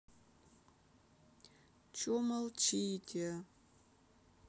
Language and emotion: Russian, sad